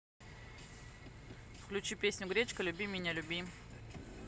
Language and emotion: Russian, neutral